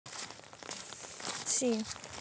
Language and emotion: Russian, neutral